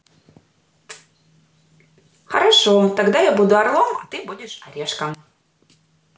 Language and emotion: Russian, positive